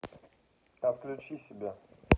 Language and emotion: Russian, neutral